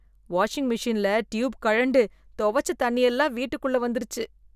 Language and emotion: Tamil, disgusted